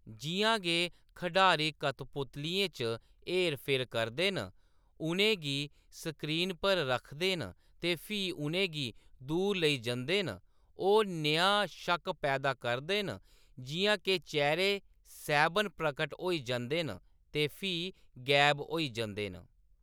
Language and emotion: Dogri, neutral